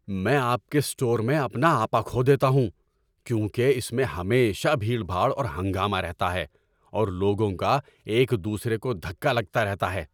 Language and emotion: Urdu, angry